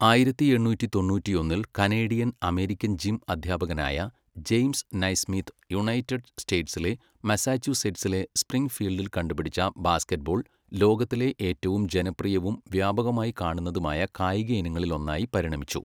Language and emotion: Malayalam, neutral